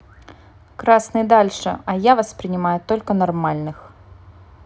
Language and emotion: Russian, neutral